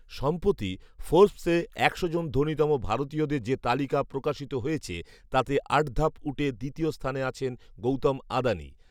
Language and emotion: Bengali, neutral